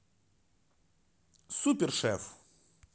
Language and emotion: Russian, positive